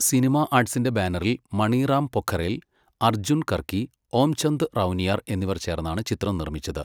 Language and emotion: Malayalam, neutral